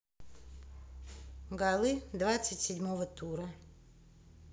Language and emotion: Russian, neutral